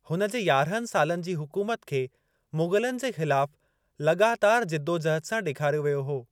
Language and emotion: Sindhi, neutral